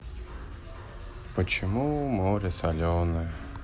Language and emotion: Russian, sad